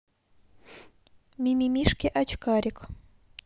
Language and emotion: Russian, neutral